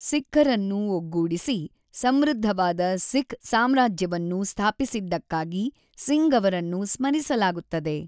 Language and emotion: Kannada, neutral